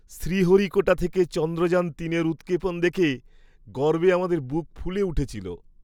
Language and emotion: Bengali, happy